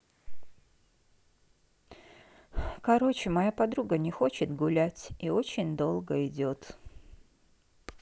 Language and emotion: Russian, sad